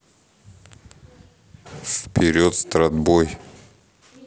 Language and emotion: Russian, neutral